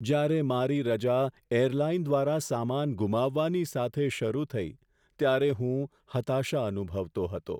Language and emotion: Gujarati, sad